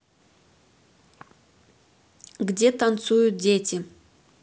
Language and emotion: Russian, neutral